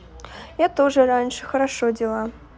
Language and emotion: Russian, neutral